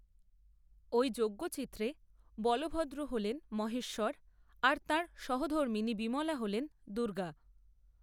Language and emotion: Bengali, neutral